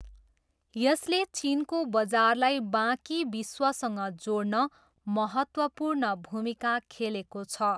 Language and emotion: Nepali, neutral